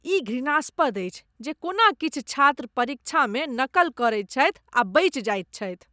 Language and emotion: Maithili, disgusted